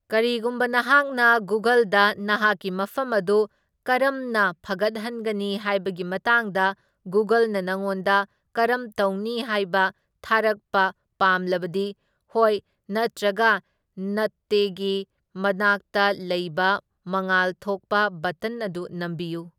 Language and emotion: Manipuri, neutral